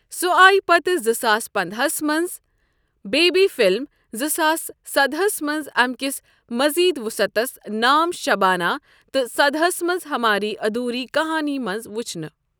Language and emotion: Kashmiri, neutral